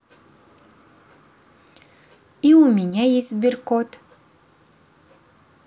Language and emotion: Russian, positive